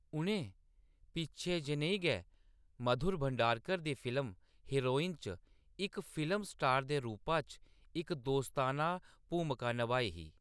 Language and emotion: Dogri, neutral